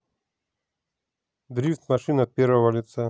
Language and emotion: Russian, neutral